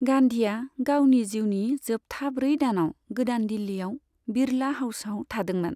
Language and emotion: Bodo, neutral